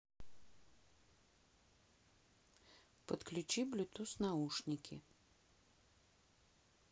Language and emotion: Russian, neutral